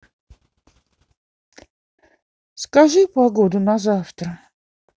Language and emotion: Russian, neutral